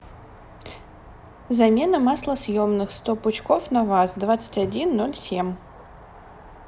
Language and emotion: Russian, neutral